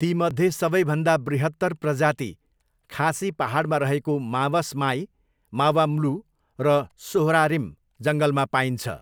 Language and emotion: Nepali, neutral